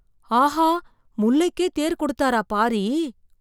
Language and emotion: Tamil, surprised